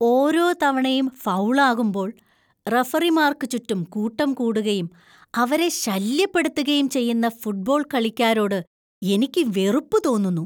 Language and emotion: Malayalam, disgusted